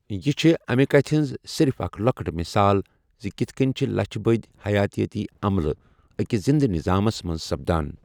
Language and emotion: Kashmiri, neutral